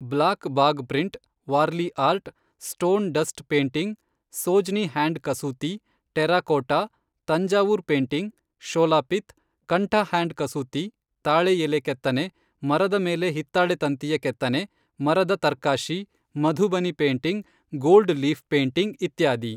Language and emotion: Kannada, neutral